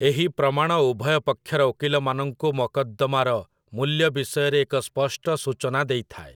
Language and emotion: Odia, neutral